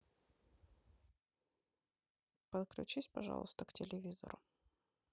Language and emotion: Russian, neutral